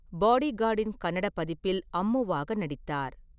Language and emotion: Tamil, neutral